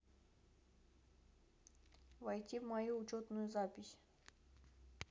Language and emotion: Russian, neutral